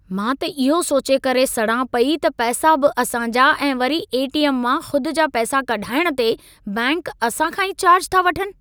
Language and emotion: Sindhi, angry